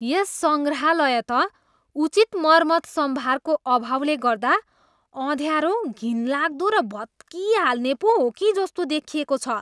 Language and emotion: Nepali, disgusted